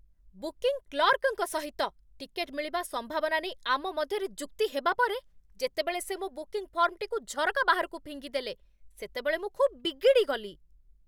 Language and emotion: Odia, angry